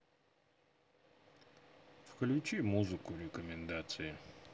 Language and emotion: Russian, neutral